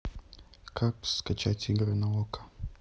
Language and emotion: Russian, neutral